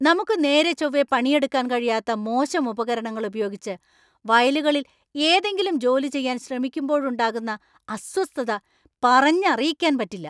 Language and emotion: Malayalam, angry